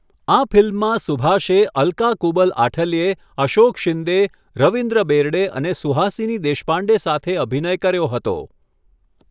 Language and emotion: Gujarati, neutral